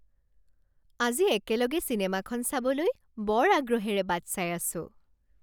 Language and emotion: Assamese, happy